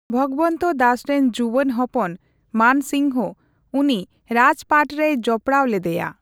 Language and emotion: Santali, neutral